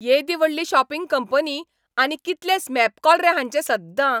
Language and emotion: Goan Konkani, angry